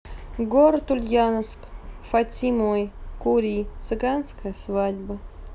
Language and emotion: Russian, neutral